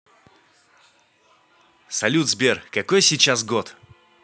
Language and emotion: Russian, positive